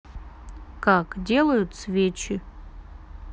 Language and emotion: Russian, neutral